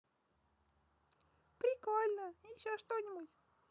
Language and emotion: Russian, positive